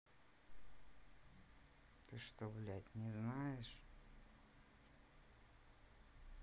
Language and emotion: Russian, neutral